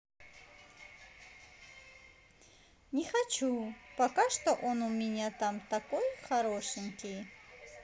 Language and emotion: Russian, positive